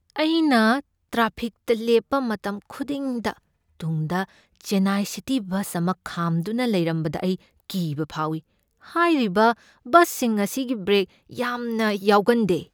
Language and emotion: Manipuri, fearful